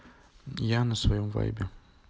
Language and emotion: Russian, neutral